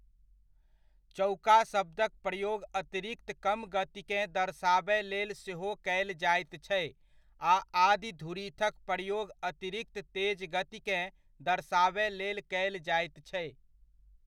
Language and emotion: Maithili, neutral